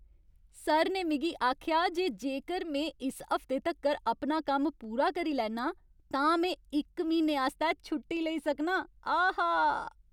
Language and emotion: Dogri, happy